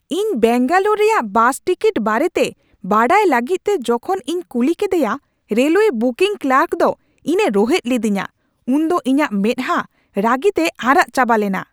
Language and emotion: Santali, angry